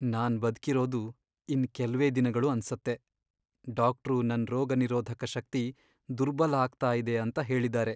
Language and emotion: Kannada, sad